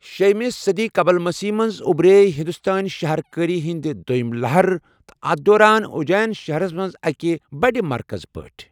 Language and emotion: Kashmiri, neutral